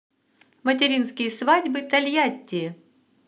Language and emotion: Russian, positive